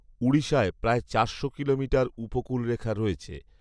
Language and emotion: Bengali, neutral